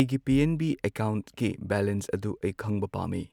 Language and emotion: Manipuri, neutral